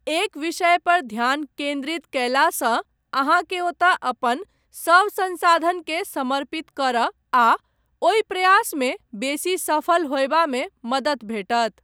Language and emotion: Maithili, neutral